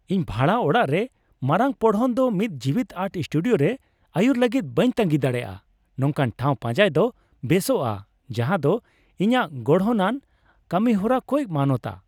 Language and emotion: Santali, happy